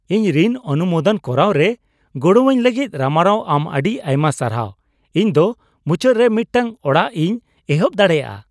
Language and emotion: Santali, happy